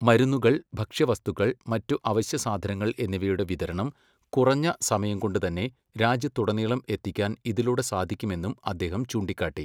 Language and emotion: Malayalam, neutral